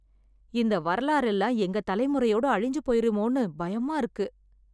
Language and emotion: Tamil, fearful